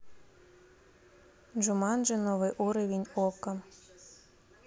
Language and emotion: Russian, neutral